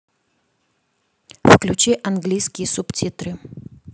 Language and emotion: Russian, neutral